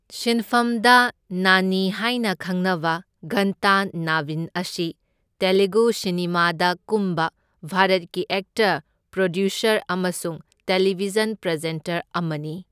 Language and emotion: Manipuri, neutral